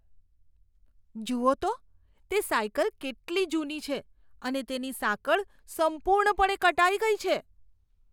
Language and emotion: Gujarati, disgusted